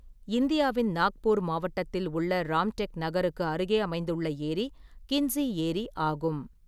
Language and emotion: Tamil, neutral